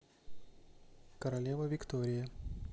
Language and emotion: Russian, neutral